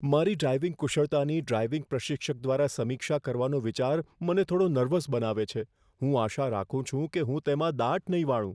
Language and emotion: Gujarati, fearful